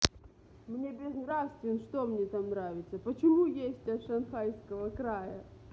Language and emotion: Russian, angry